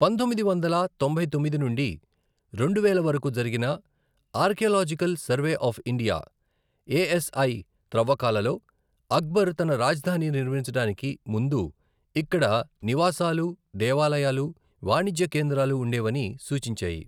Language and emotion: Telugu, neutral